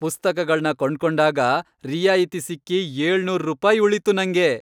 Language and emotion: Kannada, happy